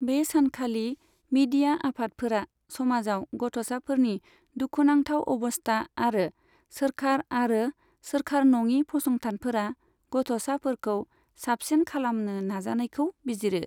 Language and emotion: Bodo, neutral